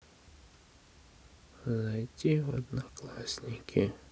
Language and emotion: Russian, sad